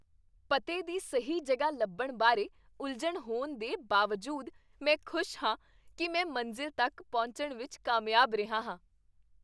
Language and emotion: Punjabi, happy